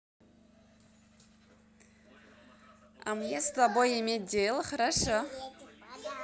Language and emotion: Russian, positive